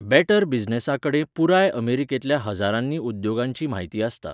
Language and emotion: Goan Konkani, neutral